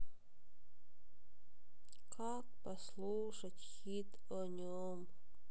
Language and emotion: Russian, sad